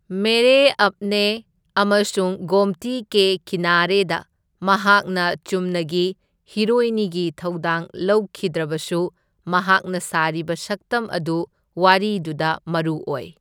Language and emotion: Manipuri, neutral